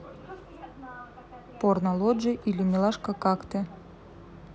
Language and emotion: Russian, neutral